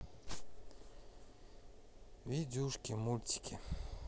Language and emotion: Russian, sad